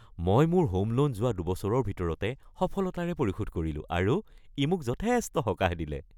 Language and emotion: Assamese, happy